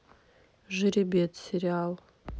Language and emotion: Russian, neutral